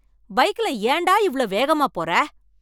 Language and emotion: Tamil, angry